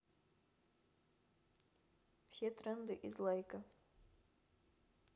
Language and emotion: Russian, neutral